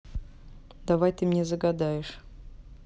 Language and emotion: Russian, neutral